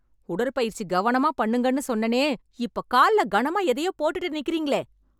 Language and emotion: Tamil, angry